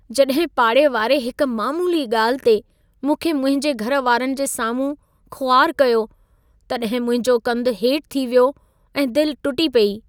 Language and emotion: Sindhi, sad